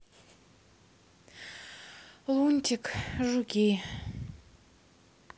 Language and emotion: Russian, sad